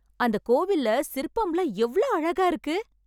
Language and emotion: Tamil, happy